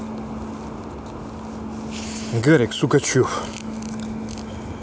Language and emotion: Russian, neutral